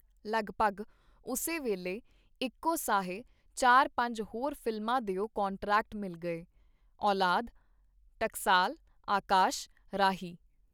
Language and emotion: Punjabi, neutral